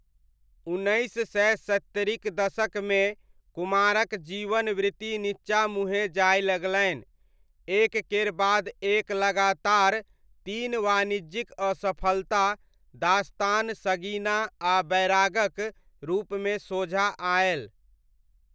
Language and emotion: Maithili, neutral